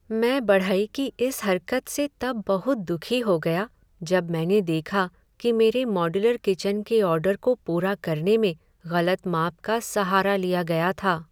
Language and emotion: Hindi, sad